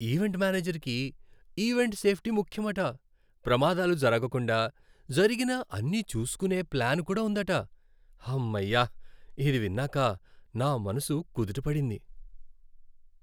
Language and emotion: Telugu, happy